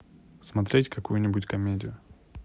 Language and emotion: Russian, neutral